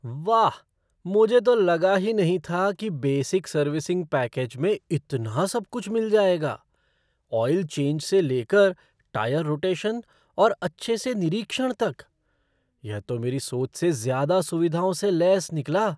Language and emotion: Hindi, surprised